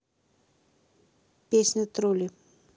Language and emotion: Russian, neutral